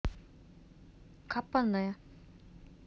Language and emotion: Russian, neutral